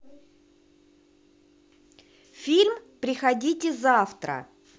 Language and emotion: Russian, positive